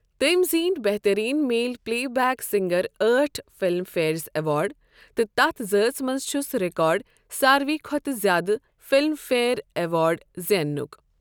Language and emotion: Kashmiri, neutral